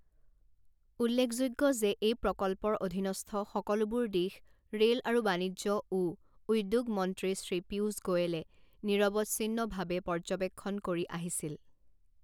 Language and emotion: Assamese, neutral